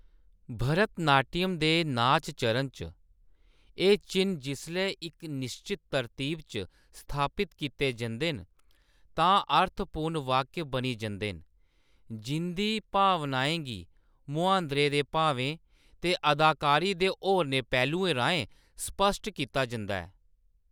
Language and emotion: Dogri, neutral